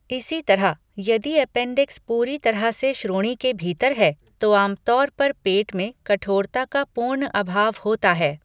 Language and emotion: Hindi, neutral